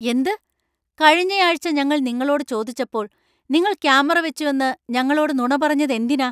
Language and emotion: Malayalam, angry